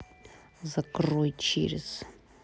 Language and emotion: Russian, angry